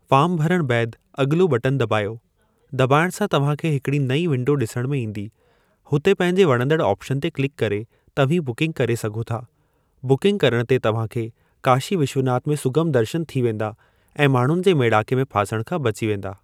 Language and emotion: Sindhi, neutral